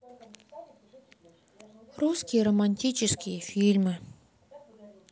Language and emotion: Russian, sad